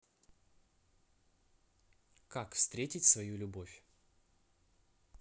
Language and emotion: Russian, neutral